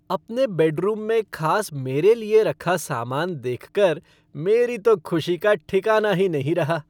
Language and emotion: Hindi, happy